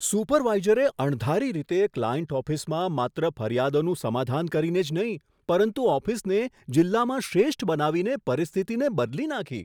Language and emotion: Gujarati, surprised